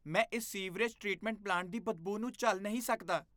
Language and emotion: Punjabi, disgusted